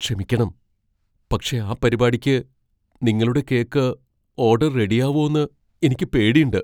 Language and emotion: Malayalam, fearful